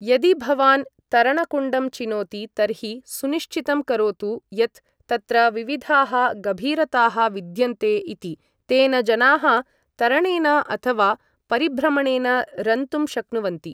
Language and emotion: Sanskrit, neutral